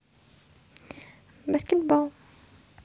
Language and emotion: Russian, neutral